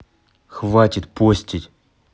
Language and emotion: Russian, angry